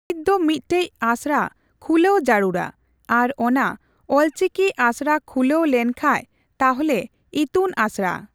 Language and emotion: Santali, neutral